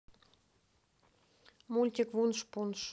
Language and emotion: Russian, neutral